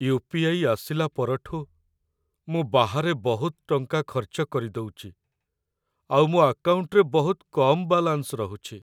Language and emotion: Odia, sad